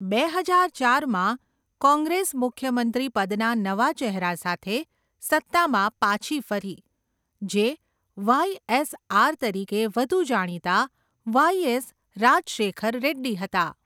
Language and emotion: Gujarati, neutral